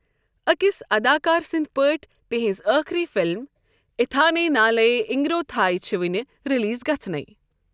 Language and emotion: Kashmiri, neutral